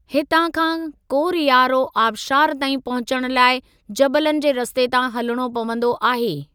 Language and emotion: Sindhi, neutral